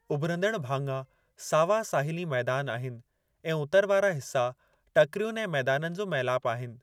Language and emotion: Sindhi, neutral